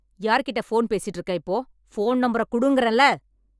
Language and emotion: Tamil, angry